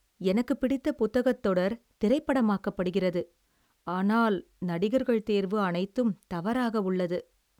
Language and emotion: Tamil, sad